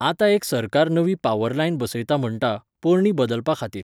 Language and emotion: Goan Konkani, neutral